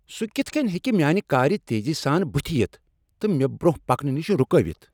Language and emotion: Kashmiri, angry